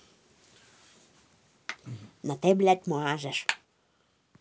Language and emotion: Russian, angry